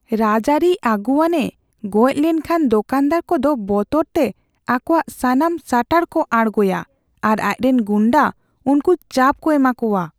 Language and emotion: Santali, fearful